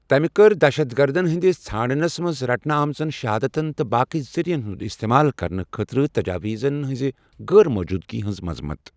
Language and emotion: Kashmiri, neutral